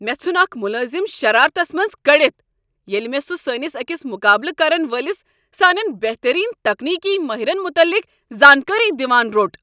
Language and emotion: Kashmiri, angry